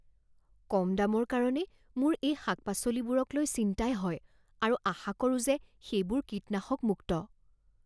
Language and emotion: Assamese, fearful